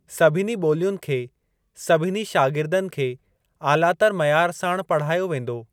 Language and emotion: Sindhi, neutral